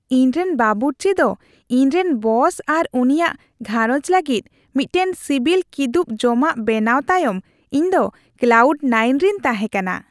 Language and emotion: Santali, happy